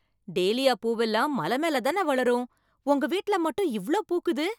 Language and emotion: Tamil, surprised